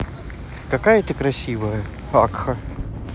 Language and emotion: Russian, positive